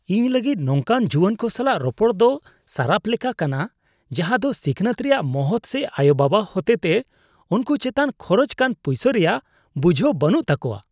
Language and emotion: Santali, disgusted